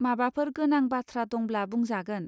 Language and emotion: Bodo, neutral